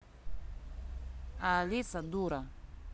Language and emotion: Russian, neutral